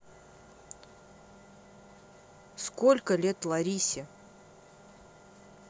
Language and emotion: Russian, neutral